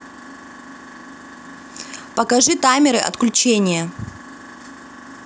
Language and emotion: Russian, angry